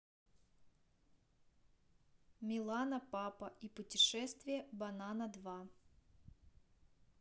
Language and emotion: Russian, neutral